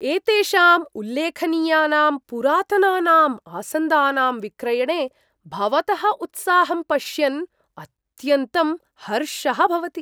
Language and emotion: Sanskrit, surprised